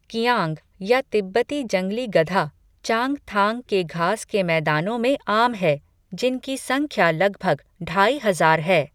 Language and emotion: Hindi, neutral